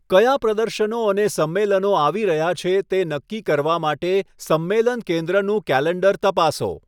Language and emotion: Gujarati, neutral